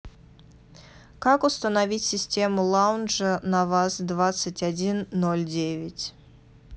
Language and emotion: Russian, neutral